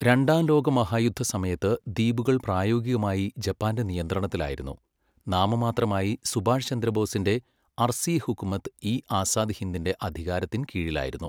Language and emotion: Malayalam, neutral